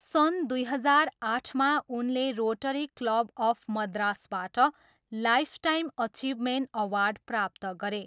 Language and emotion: Nepali, neutral